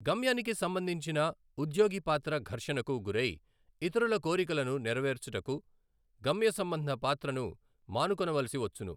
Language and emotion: Telugu, neutral